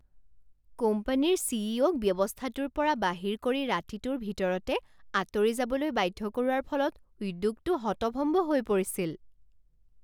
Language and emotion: Assamese, surprised